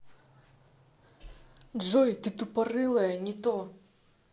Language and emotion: Russian, angry